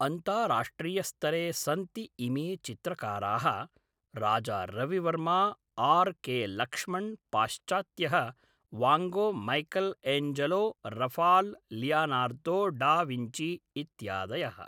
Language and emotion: Sanskrit, neutral